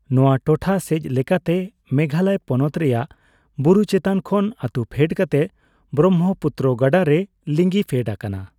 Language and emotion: Santali, neutral